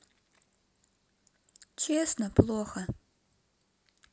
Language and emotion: Russian, sad